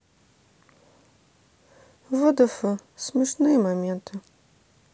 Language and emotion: Russian, sad